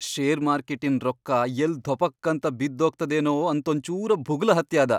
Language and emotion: Kannada, fearful